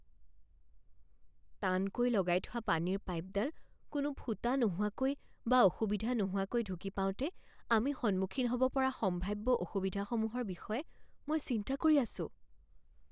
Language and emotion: Assamese, fearful